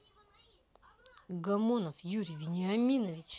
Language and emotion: Russian, angry